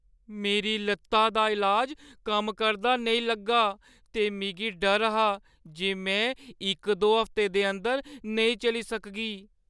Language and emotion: Dogri, fearful